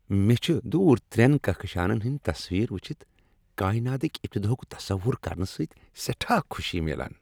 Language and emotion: Kashmiri, happy